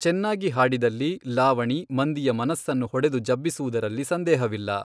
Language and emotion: Kannada, neutral